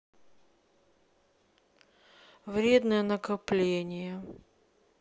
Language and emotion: Russian, sad